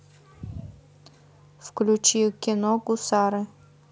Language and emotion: Russian, neutral